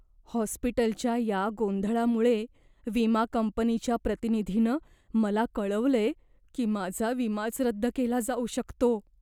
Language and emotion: Marathi, fearful